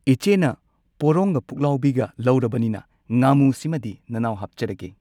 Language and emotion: Manipuri, neutral